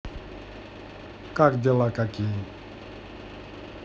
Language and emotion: Russian, neutral